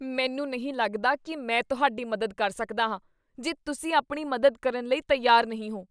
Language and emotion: Punjabi, disgusted